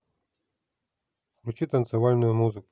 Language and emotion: Russian, neutral